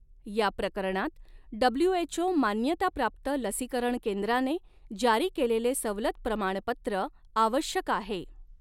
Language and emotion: Marathi, neutral